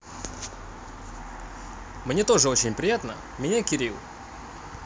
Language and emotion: Russian, positive